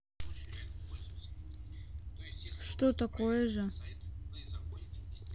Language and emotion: Russian, sad